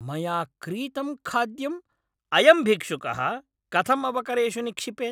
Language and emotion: Sanskrit, angry